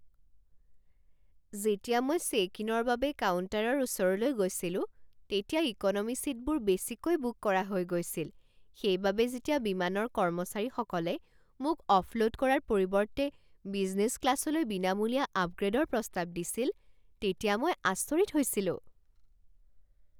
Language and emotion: Assamese, surprised